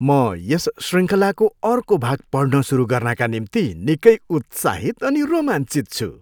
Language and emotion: Nepali, happy